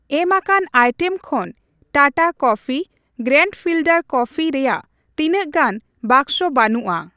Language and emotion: Santali, neutral